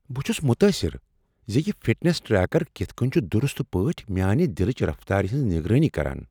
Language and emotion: Kashmiri, surprised